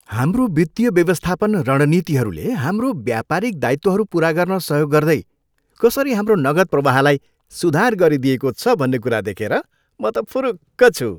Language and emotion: Nepali, happy